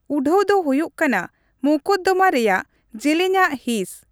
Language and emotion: Santali, neutral